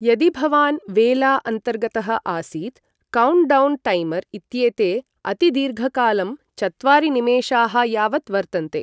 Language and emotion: Sanskrit, neutral